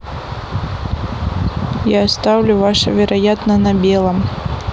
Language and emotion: Russian, neutral